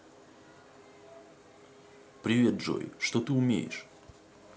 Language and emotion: Russian, neutral